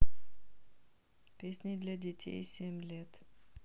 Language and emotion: Russian, neutral